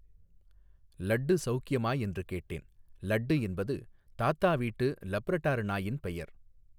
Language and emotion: Tamil, neutral